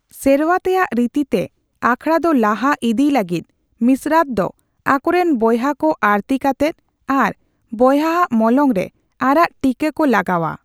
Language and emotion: Santali, neutral